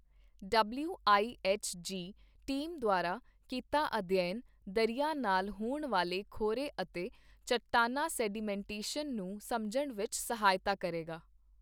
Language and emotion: Punjabi, neutral